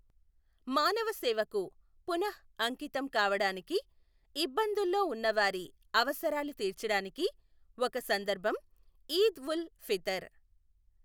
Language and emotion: Telugu, neutral